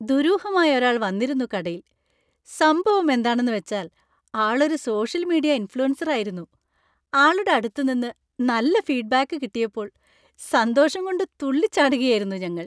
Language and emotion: Malayalam, happy